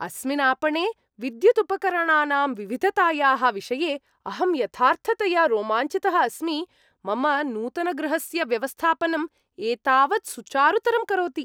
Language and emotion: Sanskrit, happy